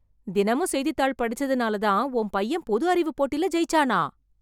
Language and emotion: Tamil, surprised